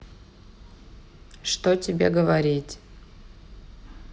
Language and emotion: Russian, sad